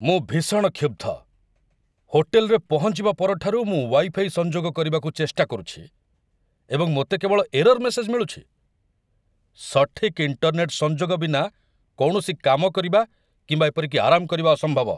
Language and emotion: Odia, angry